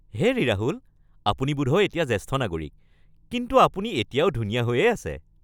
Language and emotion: Assamese, happy